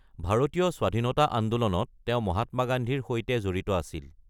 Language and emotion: Assamese, neutral